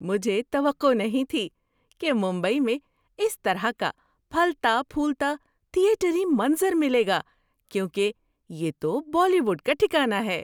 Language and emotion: Urdu, surprised